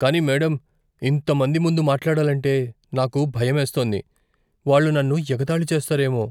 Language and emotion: Telugu, fearful